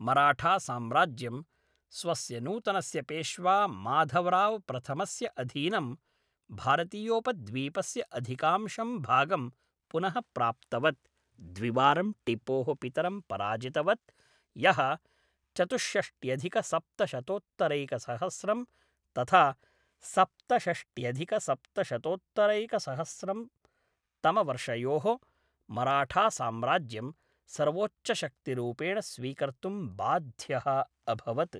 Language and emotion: Sanskrit, neutral